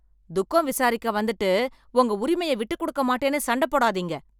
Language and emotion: Tamil, angry